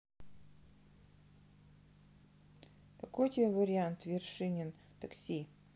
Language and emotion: Russian, neutral